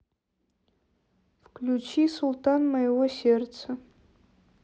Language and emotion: Russian, neutral